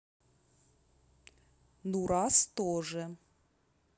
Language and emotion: Russian, neutral